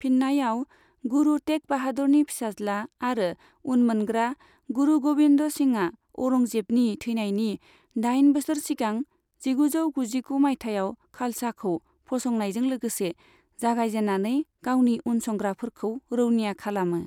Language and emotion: Bodo, neutral